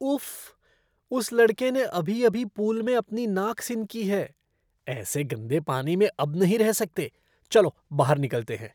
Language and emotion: Hindi, disgusted